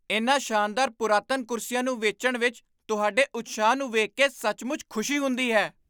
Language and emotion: Punjabi, surprised